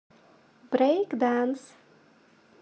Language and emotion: Russian, positive